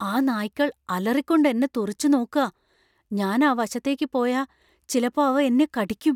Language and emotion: Malayalam, fearful